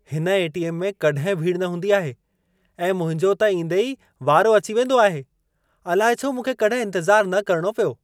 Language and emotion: Sindhi, surprised